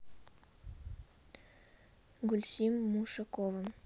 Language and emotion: Russian, neutral